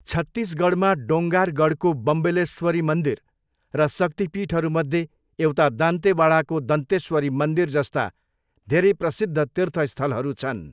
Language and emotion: Nepali, neutral